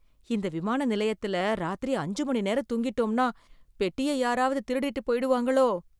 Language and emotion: Tamil, fearful